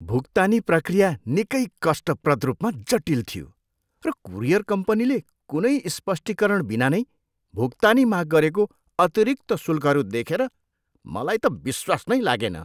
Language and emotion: Nepali, disgusted